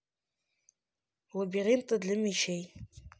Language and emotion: Russian, neutral